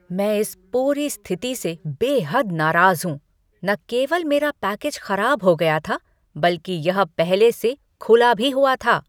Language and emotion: Hindi, angry